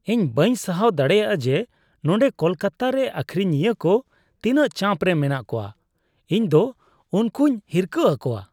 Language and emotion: Santali, disgusted